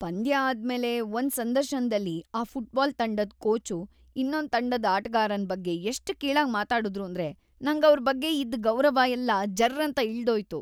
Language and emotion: Kannada, disgusted